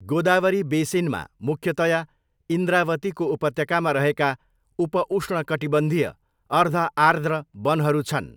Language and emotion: Nepali, neutral